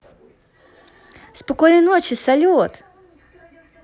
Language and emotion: Russian, positive